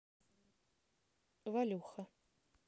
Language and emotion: Russian, neutral